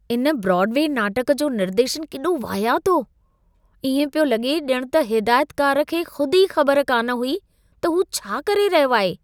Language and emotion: Sindhi, disgusted